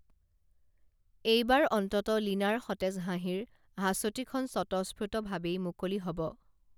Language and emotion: Assamese, neutral